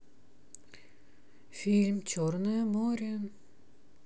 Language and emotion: Russian, neutral